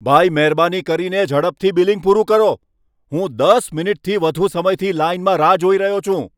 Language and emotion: Gujarati, angry